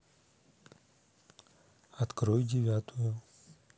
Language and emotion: Russian, neutral